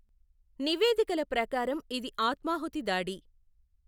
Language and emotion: Telugu, neutral